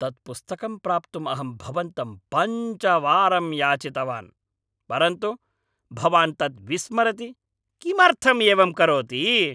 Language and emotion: Sanskrit, angry